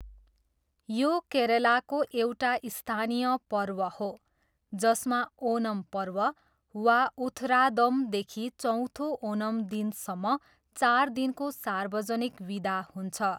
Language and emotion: Nepali, neutral